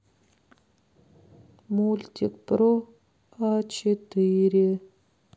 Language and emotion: Russian, sad